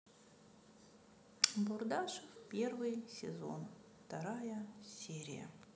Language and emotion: Russian, sad